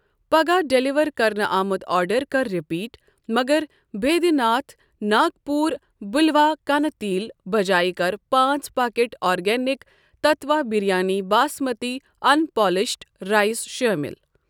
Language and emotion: Kashmiri, neutral